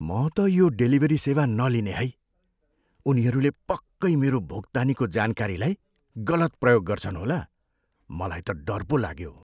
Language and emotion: Nepali, fearful